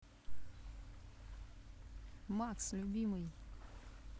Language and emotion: Russian, neutral